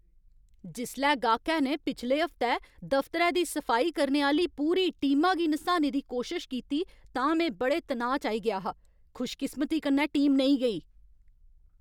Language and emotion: Dogri, angry